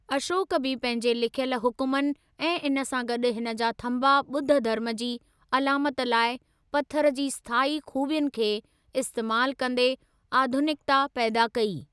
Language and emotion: Sindhi, neutral